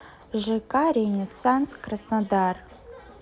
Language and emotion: Russian, neutral